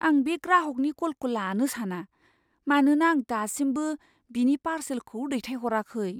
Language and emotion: Bodo, fearful